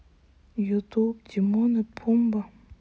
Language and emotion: Russian, sad